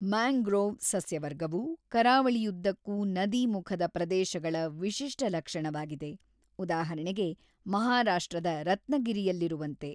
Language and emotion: Kannada, neutral